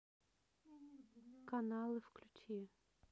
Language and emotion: Russian, neutral